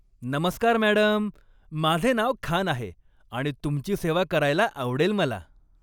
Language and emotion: Marathi, happy